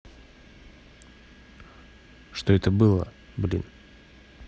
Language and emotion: Russian, neutral